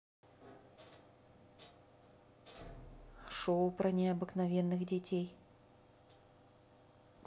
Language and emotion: Russian, neutral